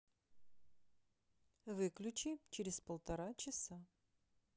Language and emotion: Russian, neutral